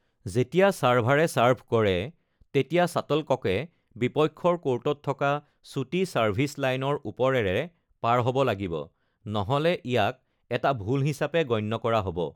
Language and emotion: Assamese, neutral